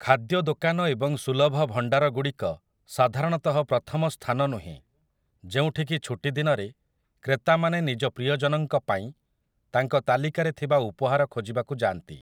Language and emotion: Odia, neutral